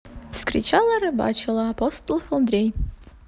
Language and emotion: Russian, positive